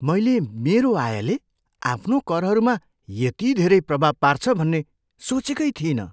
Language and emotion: Nepali, surprised